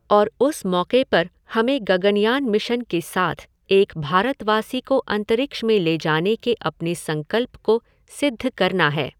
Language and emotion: Hindi, neutral